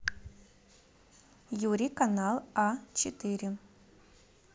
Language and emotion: Russian, neutral